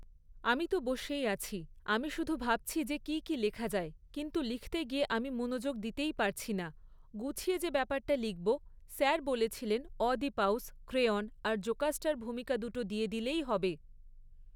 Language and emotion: Bengali, neutral